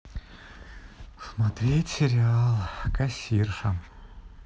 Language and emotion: Russian, sad